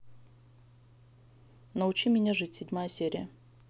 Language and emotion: Russian, neutral